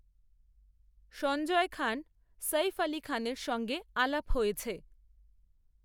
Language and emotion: Bengali, neutral